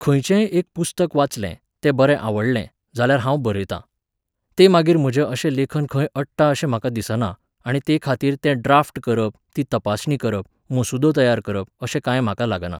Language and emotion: Goan Konkani, neutral